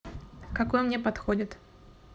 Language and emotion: Russian, neutral